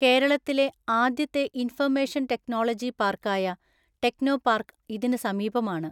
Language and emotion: Malayalam, neutral